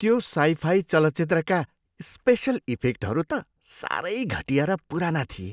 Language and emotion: Nepali, disgusted